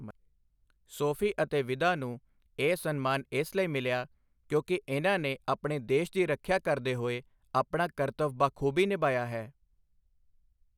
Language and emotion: Punjabi, neutral